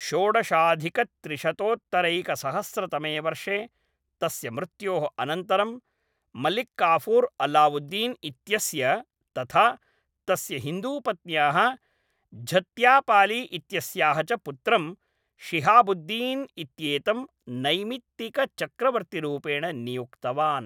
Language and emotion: Sanskrit, neutral